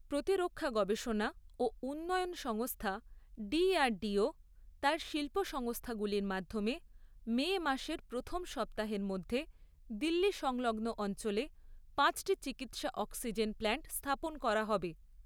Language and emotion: Bengali, neutral